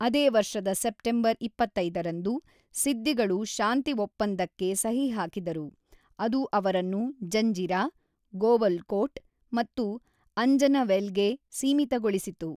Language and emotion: Kannada, neutral